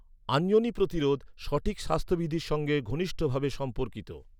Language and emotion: Bengali, neutral